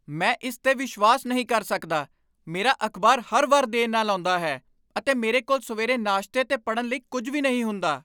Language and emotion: Punjabi, angry